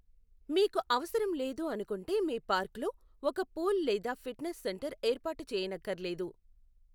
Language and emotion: Telugu, neutral